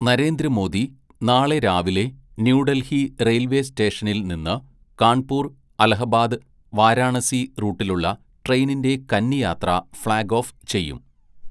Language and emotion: Malayalam, neutral